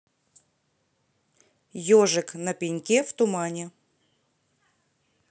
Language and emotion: Russian, neutral